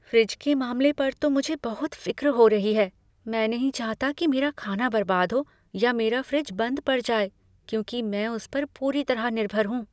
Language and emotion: Hindi, fearful